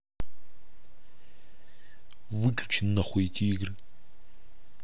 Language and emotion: Russian, angry